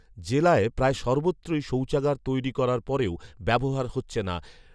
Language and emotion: Bengali, neutral